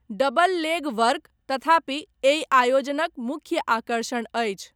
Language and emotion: Maithili, neutral